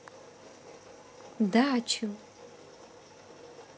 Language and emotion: Russian, positive